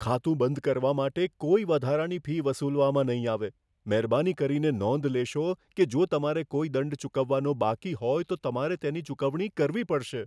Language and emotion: Gujarati, fearful